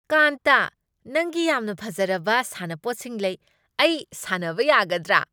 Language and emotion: Manipuri, happy